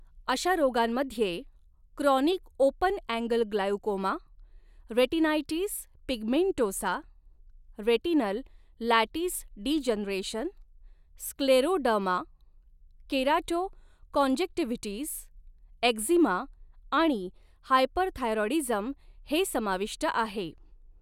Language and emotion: Marathi, neutral